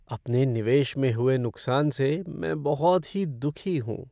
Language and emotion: Hindi, sad